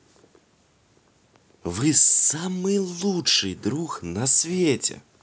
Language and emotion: Russian, positive